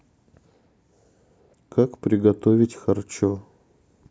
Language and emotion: Russian, neutral